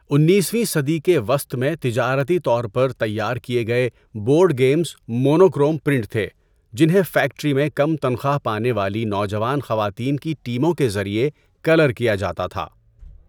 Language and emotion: Urdu, neutral